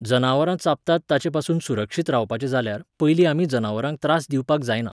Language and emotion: Goan Konkani, neutral